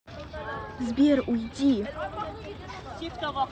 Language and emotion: Russian, angry